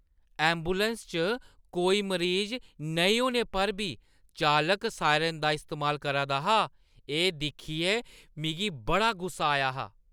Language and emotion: Dogri, disgusted